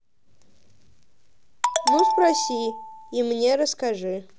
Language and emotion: Russian, neutral